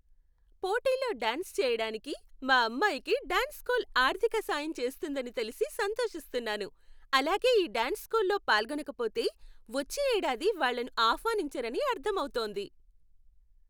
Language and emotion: Telugu, happy